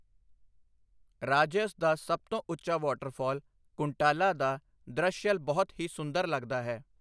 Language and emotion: Punjabi, neutral